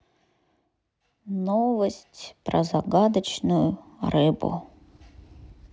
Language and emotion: Russian, sad